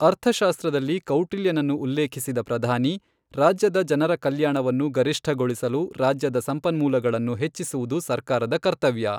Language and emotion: Kannada, neutral